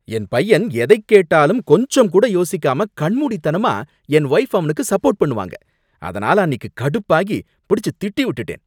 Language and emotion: Tamil, angry